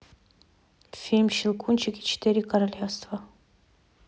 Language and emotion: Russian, neutral